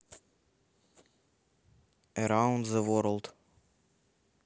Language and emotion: Russian, neutral